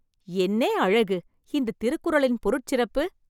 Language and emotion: Tamil, surprised